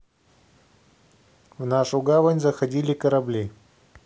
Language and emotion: Russian, neutral